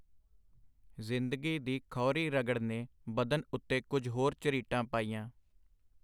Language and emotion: Punjabi, neutral